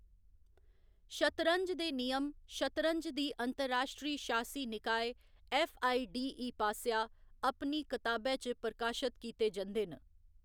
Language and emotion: Dogri, neutral